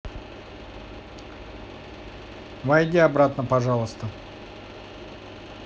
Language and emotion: Russian, neutral